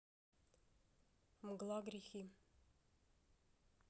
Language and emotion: Russian, neutral